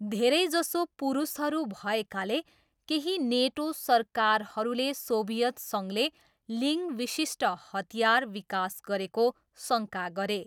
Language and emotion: Nepali, neutral